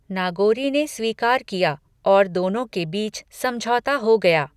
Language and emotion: Hindi, neutral